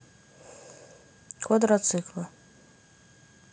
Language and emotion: Russian, neutral